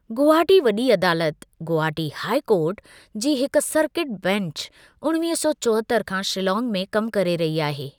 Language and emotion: Sindhi, neutral